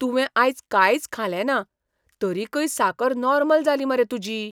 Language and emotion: Goan Konkani, surprised